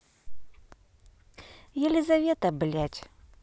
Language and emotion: Russian, angry